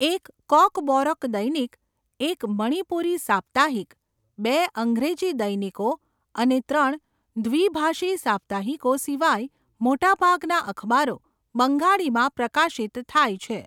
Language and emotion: Gujarati, neutral